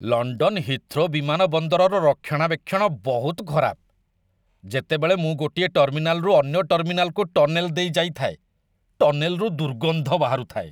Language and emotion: Odia, disgusted